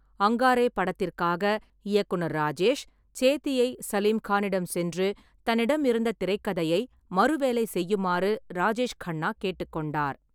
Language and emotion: Tamil, neutral